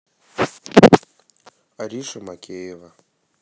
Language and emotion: Russian, neutral